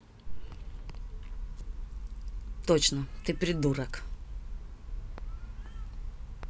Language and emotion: Russian, angry